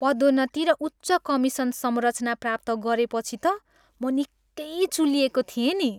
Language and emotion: Nepali, happy